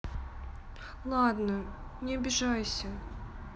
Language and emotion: Russian, sad